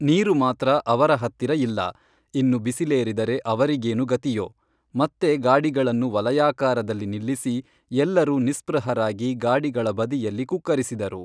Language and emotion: Kannada, neutral